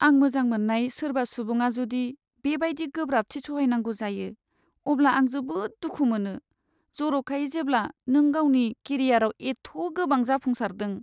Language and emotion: Bodo, sad